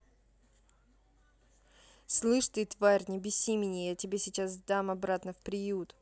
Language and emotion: Russian, angry